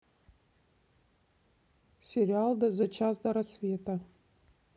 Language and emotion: Russian, neutral